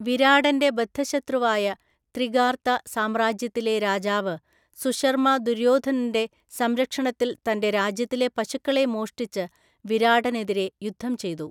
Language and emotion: Malayalam, neutral